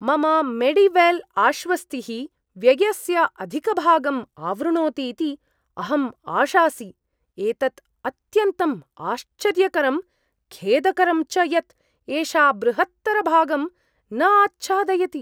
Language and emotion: Sanskrit, surprised